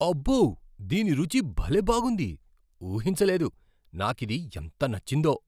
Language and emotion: Telugu, surprised